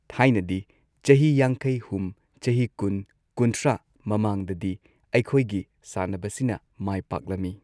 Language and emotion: Manipuri, neutral